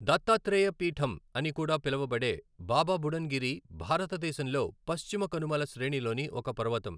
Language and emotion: Telugu, neutral